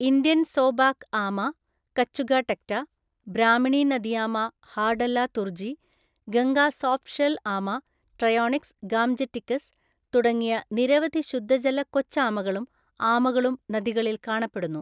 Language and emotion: Malayalam, neutral